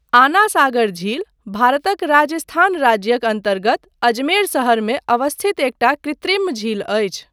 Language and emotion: Maithili, neutral